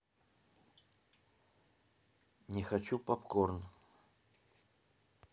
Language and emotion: Russian, neutral